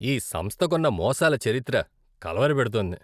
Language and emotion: Telugu, disgusted